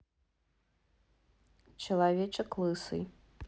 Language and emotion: Russian, neutral